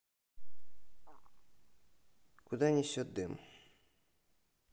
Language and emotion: Russian, neutral